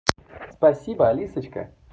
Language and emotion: Russian, positive